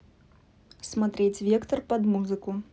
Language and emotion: Russian, neutral